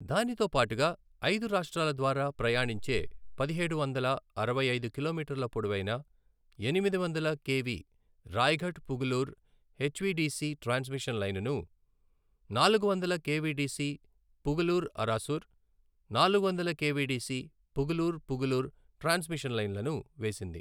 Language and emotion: Telugu, neutral